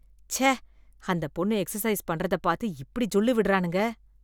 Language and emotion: Tamil, disgusted